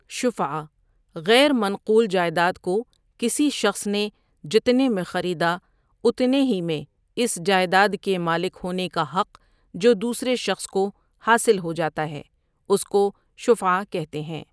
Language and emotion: Urdu, neutral